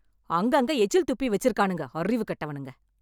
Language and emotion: Tamil, angry